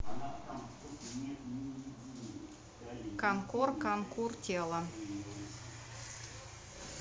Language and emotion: Russian, neutral